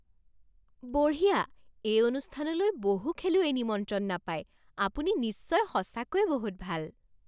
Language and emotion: Assamese, surprised